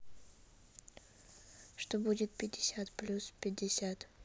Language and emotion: Russian, neutral